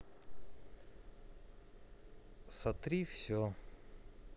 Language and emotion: Russian, sad